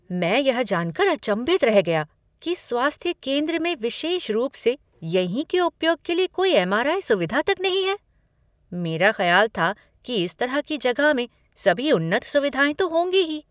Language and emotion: Hindi, surprised